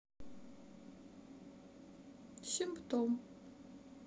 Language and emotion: Russian, sad